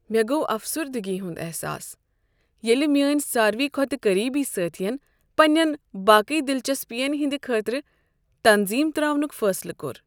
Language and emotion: Kashmiri, sad